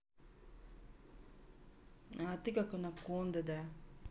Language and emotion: Russian, neutral